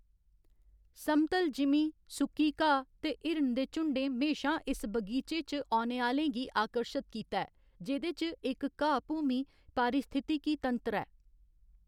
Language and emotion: Dogri, neutral